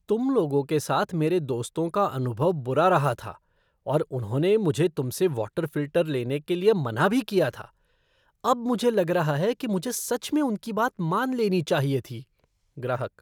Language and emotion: Hindi, disgusted